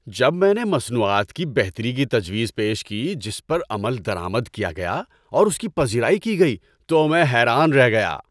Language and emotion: Urdu, happy